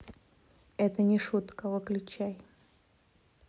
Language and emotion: Russian, neutral